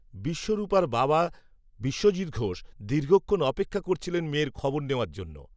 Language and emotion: Bengali, neutral